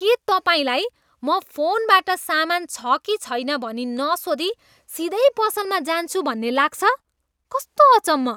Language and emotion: Nepali, disgusted